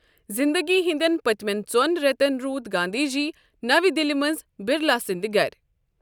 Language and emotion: Kashmiri, neutral